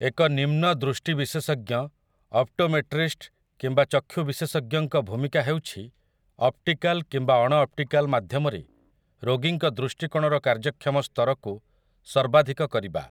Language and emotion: Odia, neutral